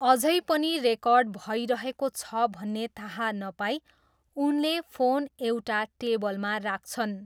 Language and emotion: Nepali, neutral